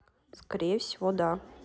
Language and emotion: Russian, neutral